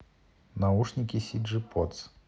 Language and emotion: Russian, neutral